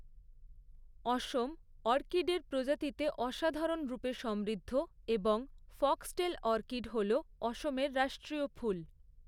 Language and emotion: Bengali, neutral